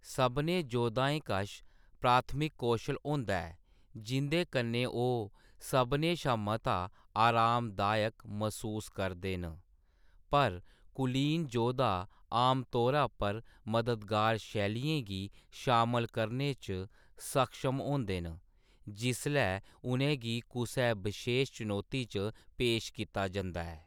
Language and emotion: Dogri, neutral